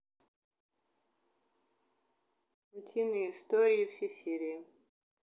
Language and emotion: Russian, neutral